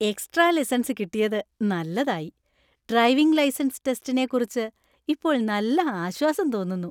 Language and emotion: Malayalam, happy